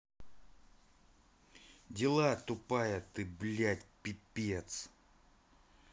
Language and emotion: Russian, angry